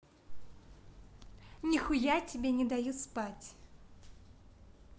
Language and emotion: Russian, neutral